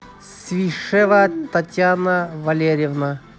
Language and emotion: Russian, neutral